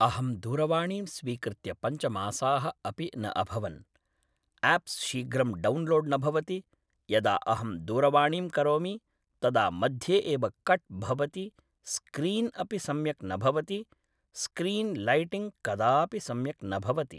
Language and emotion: Sanskrit, neutral